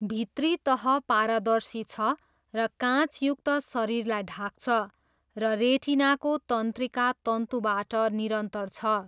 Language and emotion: Nepali, neutral